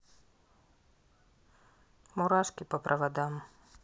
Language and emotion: Russian, sad